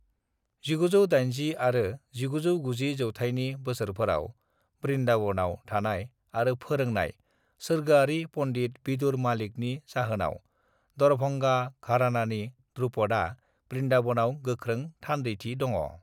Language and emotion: Bodo, neutral